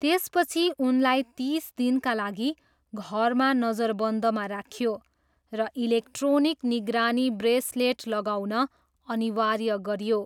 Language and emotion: Nepali, neutral